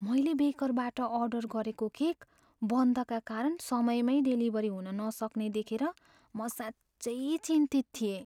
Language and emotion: Nepali, fearful